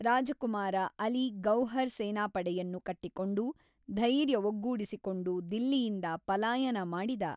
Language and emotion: Kannada, neutral